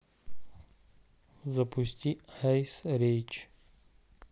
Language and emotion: Russian, neutral